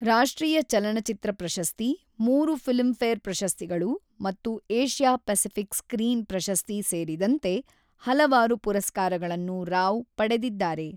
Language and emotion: Kannada, neutral